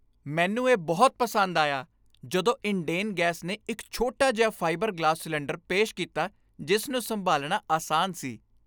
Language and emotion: Punjabi, happy